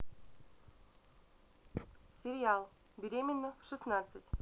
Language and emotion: Russian, neutral